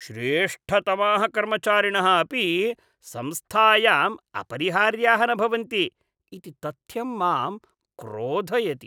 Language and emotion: Sanskrit, disgusted